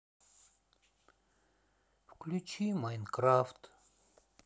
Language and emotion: Russian, sad